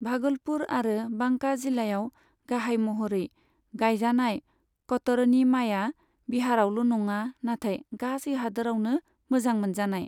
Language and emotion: Bodo, neutral